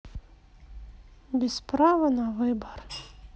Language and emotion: Russian, sad